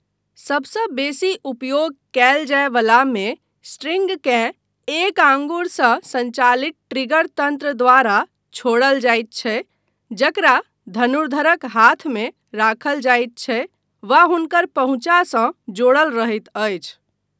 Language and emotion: Maithili, neutral